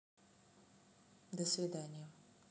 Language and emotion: Russian, neutral